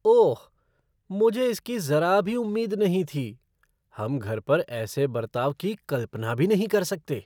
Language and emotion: Hindi, surprised